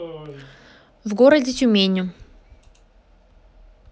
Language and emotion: Russian, neutral